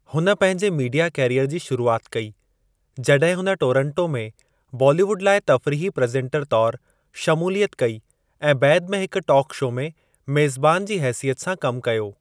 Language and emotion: Sindhi, neutral